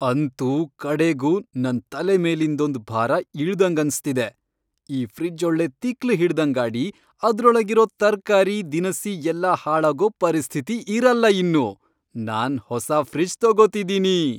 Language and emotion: Kannada, happy